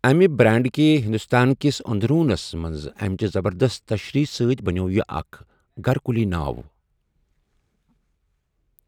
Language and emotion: Kashmiri, neutral